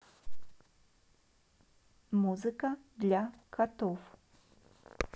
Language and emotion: Russian, neutral